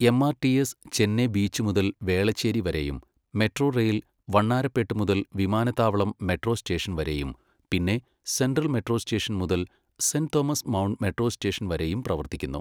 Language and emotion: Malayalam, neutral